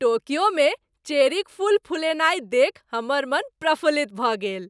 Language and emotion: Maithili, happy